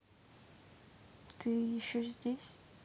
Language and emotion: Russian, sad